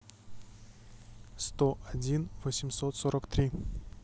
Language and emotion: Russian, neutral